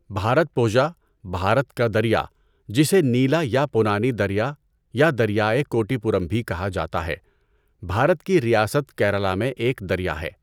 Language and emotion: Urdu, neutral